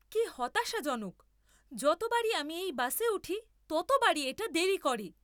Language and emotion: Bengali, angry